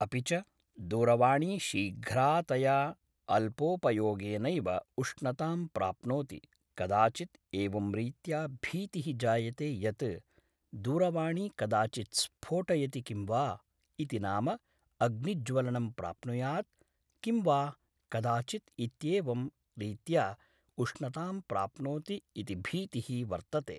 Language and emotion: Sanskrit, neutral